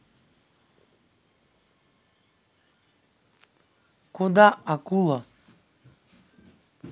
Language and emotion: Russian, neutral